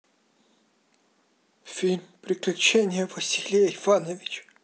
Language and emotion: Russian, sad